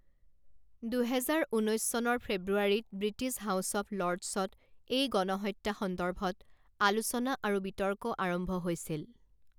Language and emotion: Assamese, neutral